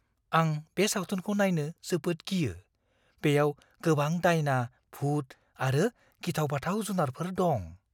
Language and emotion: Bodo, fearful